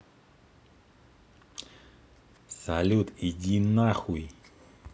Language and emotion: Russian, neutral